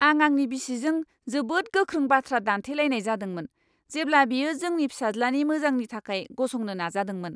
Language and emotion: Bodo, angry